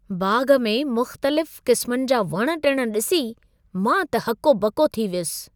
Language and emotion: Sindhi, surprised